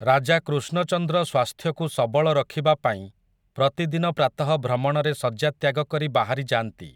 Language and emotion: Odia, neutral